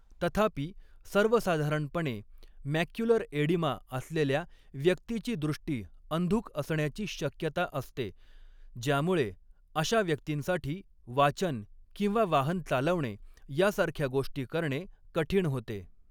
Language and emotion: Marathi, neutral